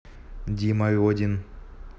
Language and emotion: Russian, neutral